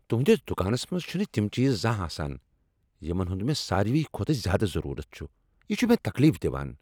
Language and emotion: Kashmiri, angry